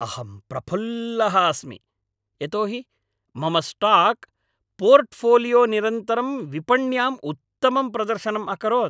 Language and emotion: Sanskrit, happy